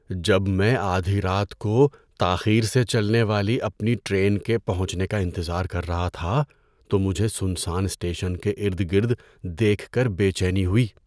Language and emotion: Urdu, fearful